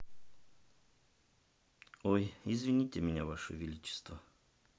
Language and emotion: Russian, sad